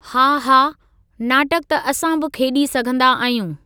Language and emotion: Sindhi, neutral